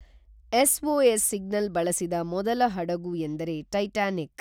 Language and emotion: Kannada, neutral